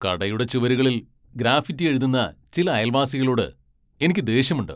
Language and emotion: Malayalam, angry